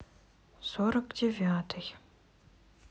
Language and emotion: Russian, neutral